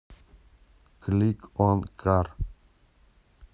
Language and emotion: Russian, neutral